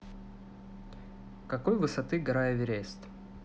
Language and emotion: Russian, neutral